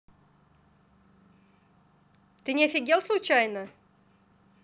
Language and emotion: Russian, angry